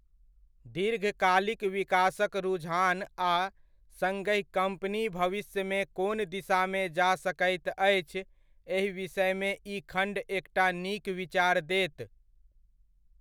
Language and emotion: Maithili, neutral